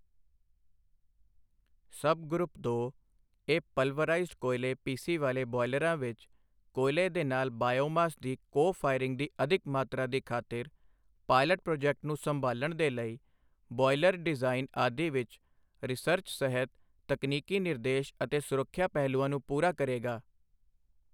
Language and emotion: Punjabi, neutral